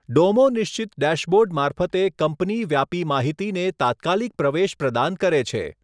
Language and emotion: Gujarati, neutral